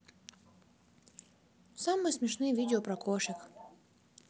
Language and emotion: Russian, neutral